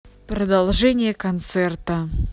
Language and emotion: Russian, angry